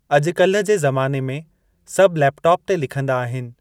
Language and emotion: Sindhi, neutral